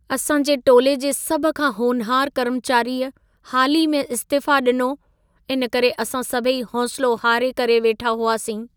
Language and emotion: Sindhi, sad